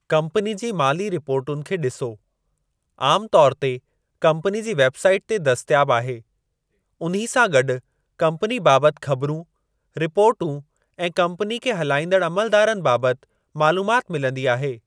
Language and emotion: Sindhi, neutral